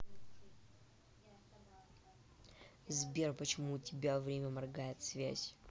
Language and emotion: Russian, angry